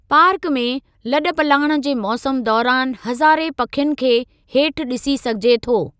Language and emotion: Sindhi, neutral